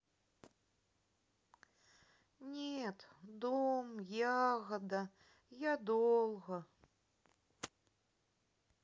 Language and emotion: Russian, sad